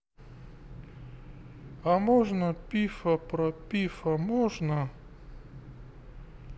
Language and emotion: Russian, neutral